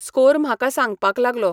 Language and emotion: Goan Konkani, neutral